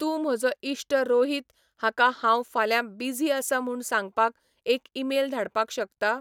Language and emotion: Goan Konkani, neutral